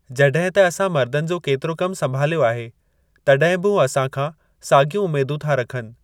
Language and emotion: Sindhi, neutral